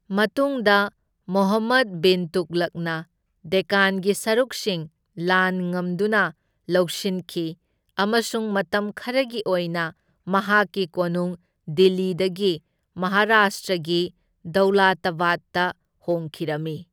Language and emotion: Manipuri, neutral